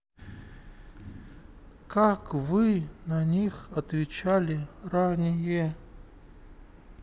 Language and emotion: Russian, sad